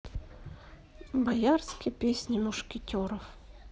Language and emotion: Russian, sad